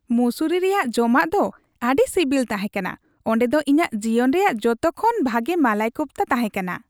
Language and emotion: Santali, happy